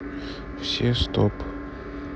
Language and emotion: Russian, neutral